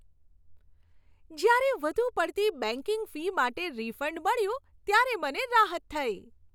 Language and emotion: Gujarati, happy